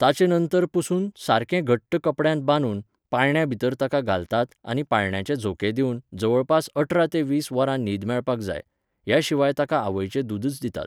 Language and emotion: Goan Konkani, neutral